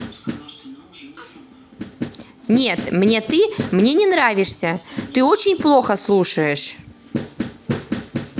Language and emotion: Russian, angry